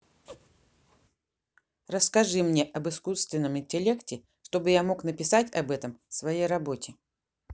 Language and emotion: Russian, neutral